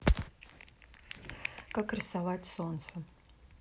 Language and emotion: Russian, neutral